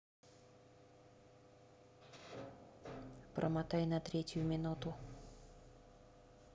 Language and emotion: Russian, neutral